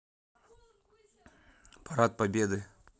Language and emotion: Russian, neutral